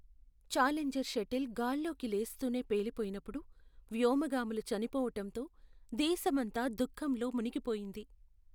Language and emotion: Telugu, sad